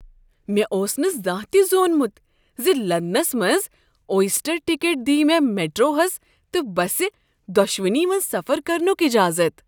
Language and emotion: Kashmiri, surprised